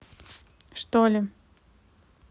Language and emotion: Russian, neutral